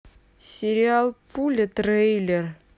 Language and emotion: Russian, neutral